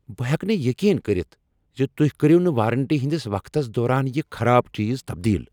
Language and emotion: Kashmiri, angry